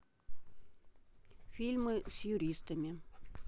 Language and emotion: Russian, neutral